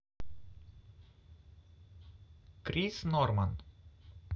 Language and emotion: Russian, neutral